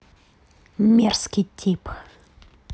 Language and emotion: Russian, angry